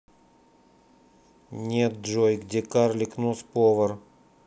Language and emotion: Russian, neutral